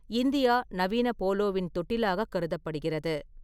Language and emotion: Tamil, neutral